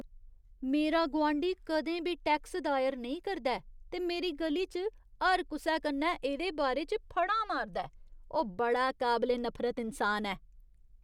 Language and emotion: Dogri, disgusted